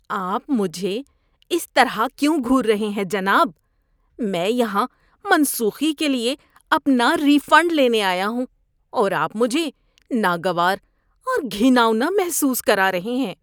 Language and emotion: Urdu, disgusted